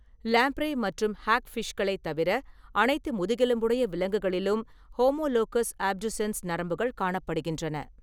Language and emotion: Tamil, neutral